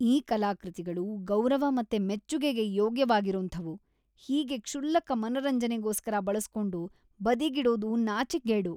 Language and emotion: Kannada, disgusted